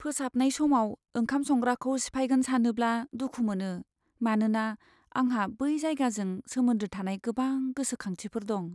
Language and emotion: Bodo, sad